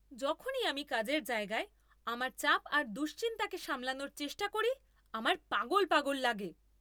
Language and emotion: Bengali, angry